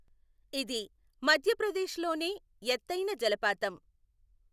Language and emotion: Telugu, neutral